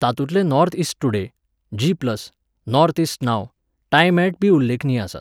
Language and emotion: Goan Konkani, neutral